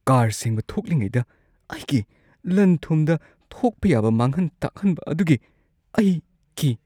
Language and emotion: Manipuri, fearful